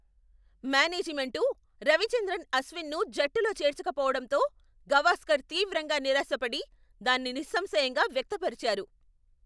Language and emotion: Telugu, angry